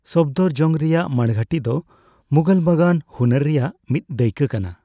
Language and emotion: Santali, neutral